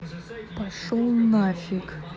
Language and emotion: Russian, angry